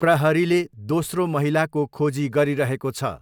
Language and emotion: Nepali, neutral